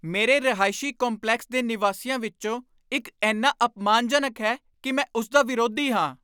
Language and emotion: Punjabi, angry